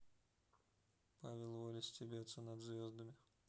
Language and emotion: Russian, neutral